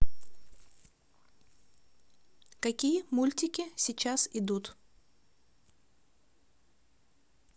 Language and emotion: Russian, neutral